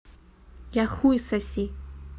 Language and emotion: Russian, neutral